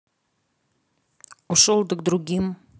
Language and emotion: Russian, neutral